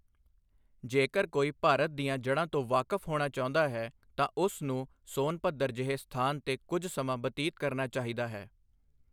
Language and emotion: Punjabi, neutral